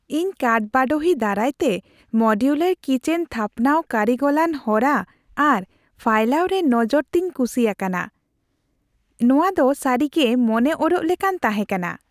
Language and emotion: Santali, happy